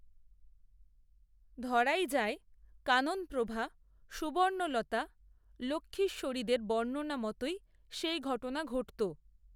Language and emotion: Bengali, neutral